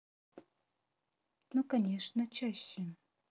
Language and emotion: Russian, neutral